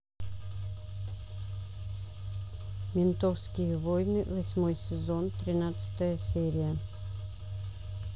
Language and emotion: Russian, neutral